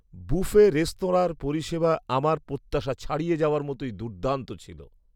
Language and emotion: Bengali, surprised